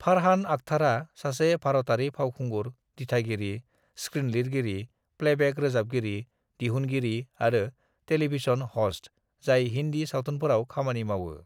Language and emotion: Bodo, neutral